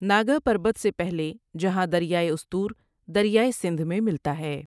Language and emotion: Urdu, neutral